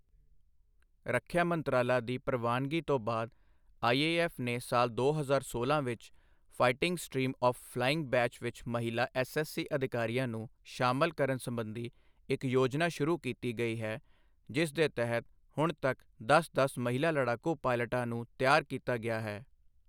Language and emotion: Punjabi, neutral